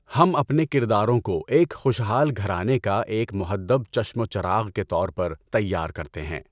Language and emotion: Urdu, neutral